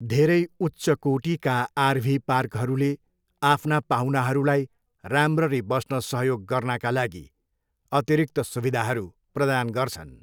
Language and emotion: Nepali, neutral